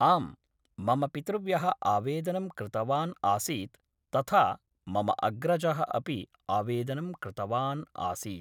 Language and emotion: Sanskrit, neutral